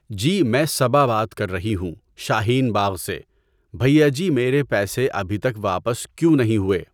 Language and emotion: Urdu, neutral